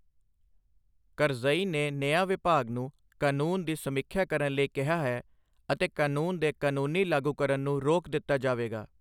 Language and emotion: Punjabi, neutral